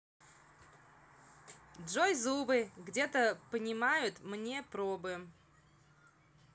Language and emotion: Russian, neutral